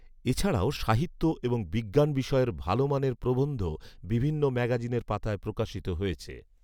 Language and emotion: Bengali, neutral